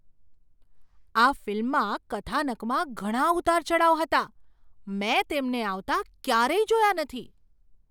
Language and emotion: Gujarati, surprised